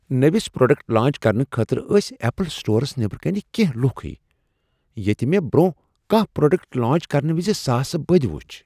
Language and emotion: Kashmiri, surprised